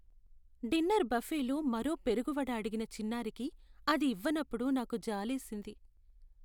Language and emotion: Telugu, sad